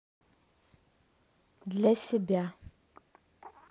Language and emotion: Russian, neutral